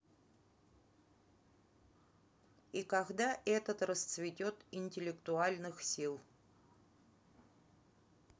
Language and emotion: Russian, neutral